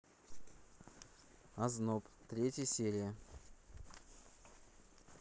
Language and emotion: Russian, neutral